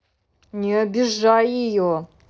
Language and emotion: Russian, angry